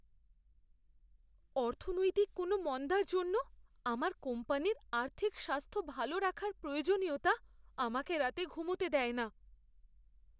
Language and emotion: Bengali, fearful